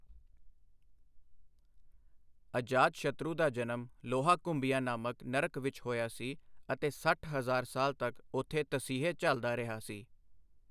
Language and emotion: Punjabi, neutral